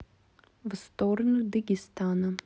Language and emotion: Russian, neutral